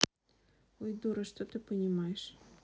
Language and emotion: Russian, neutral